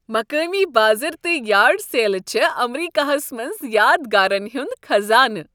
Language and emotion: Kashmiri, happy